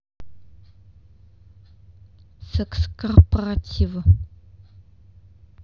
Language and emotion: Russian, neutral